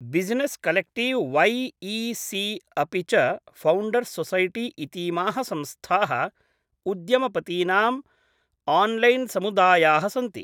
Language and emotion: Sanskrit, neutral